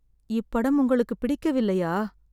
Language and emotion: Tamil, sad